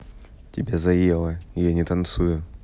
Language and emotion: Russian, neutral